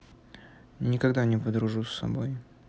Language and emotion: Russian, sad